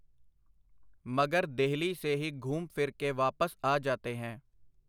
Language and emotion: Punjabi, neutral